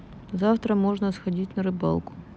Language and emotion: Russian, neutral